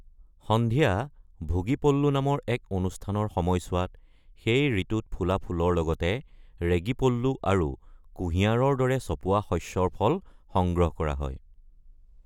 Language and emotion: Assamese, neutral